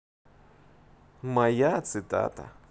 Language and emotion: Russian, positive